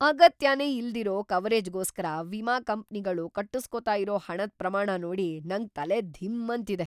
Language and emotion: Kannada, surprised